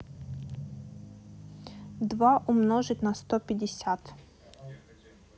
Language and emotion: Russian, neutral